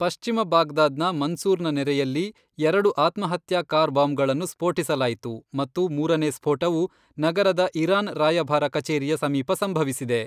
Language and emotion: Kannada, neutral